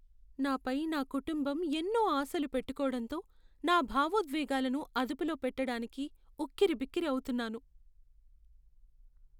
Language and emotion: Telugu, sad